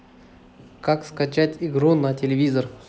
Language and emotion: Russian, neutral